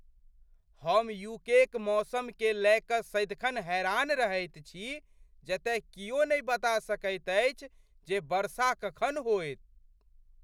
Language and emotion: Maithili, surprised